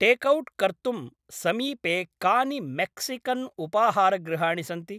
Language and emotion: Sanskrit, neutral